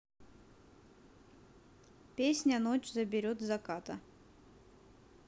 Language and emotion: Russian, neutral